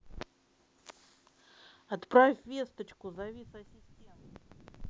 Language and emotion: Russian, neutral